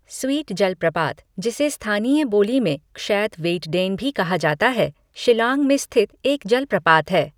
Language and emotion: Hindi, neutral